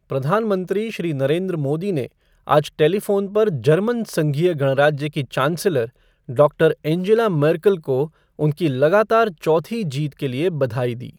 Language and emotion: Hindi, neutral